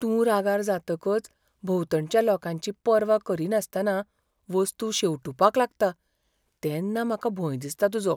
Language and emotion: Goan Konkani, fearful